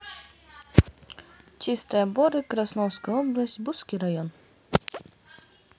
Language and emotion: Russian, neutral